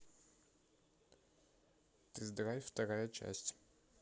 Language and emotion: Russian, neutral